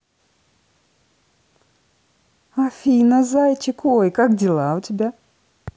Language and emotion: Russian, positive